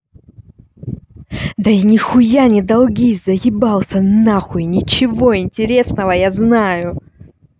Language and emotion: Russian, angry